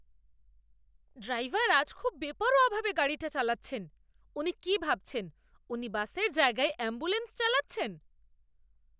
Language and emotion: Bengali, angry